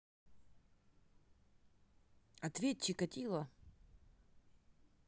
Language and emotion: Russian, neutral